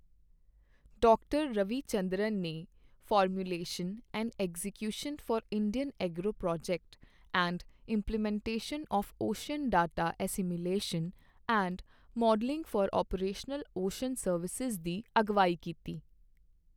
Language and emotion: Punjabi, neutral